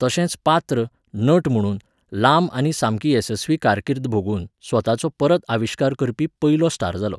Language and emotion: Goan Konkani, neutral